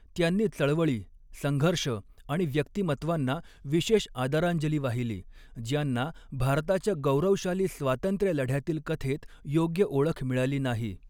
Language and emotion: Marathi, neutral